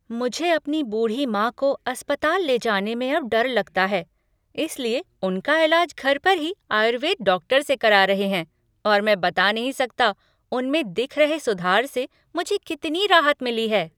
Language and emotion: Hindi, happy